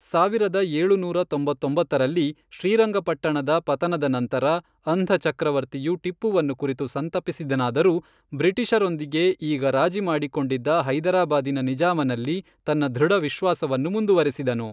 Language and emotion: Kannada, neutral